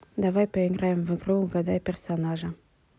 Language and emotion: Russian, neutral